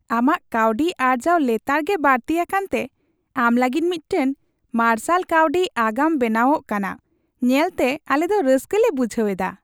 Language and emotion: Santali, happy